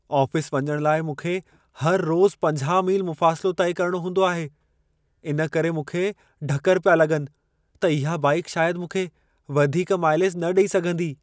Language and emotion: Sindhi, fearful